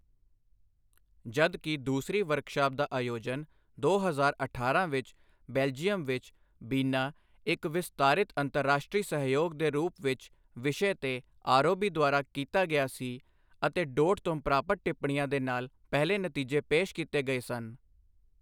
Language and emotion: Punjabi, neutral